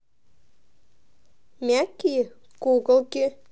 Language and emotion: Russian, neutral